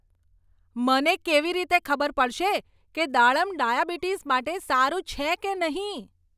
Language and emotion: Gujarati, angry